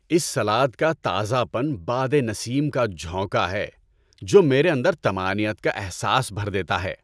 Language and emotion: Urdu, happy